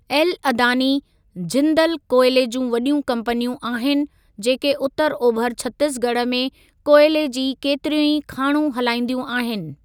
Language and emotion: Sindhi, neutral